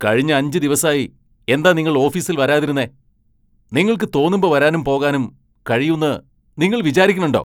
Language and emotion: Malayalam, angry